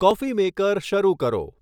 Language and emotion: Gujarati, neutral